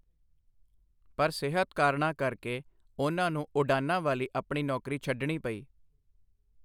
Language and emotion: Punjabi, neutral